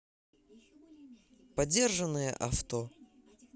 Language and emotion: Russian, neutral